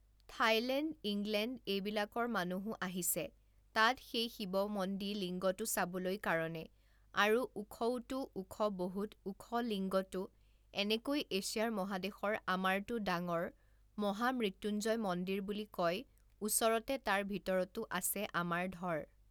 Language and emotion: Assamese, neutral